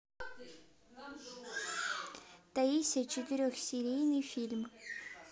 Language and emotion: Russian, neutral